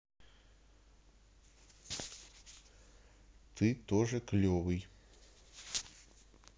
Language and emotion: Russian, neutral